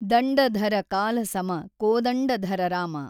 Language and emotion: Kannada, neutral